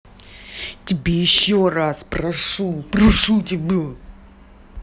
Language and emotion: Russian, angry